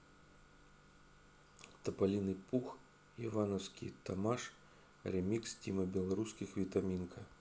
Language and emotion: Russian, neutral